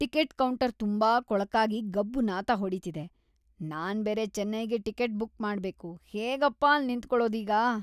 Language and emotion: Kannada, disgusted